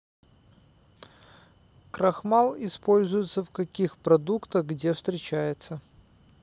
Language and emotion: Russian, neutral